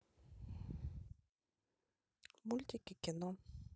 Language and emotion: Russian, neutral